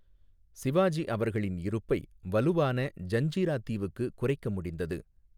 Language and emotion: Tamil, neutral